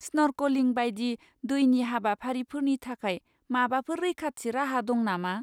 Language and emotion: Bodo, fearful